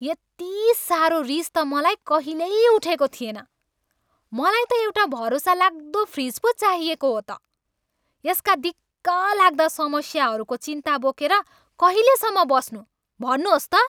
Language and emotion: Nepali, angry